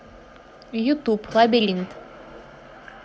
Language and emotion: Russian, neutral